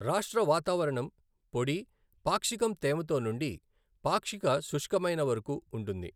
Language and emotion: Telugu, neutral